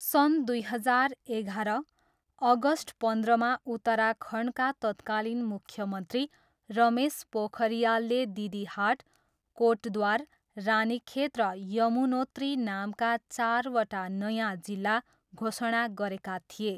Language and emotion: Nepali, neutral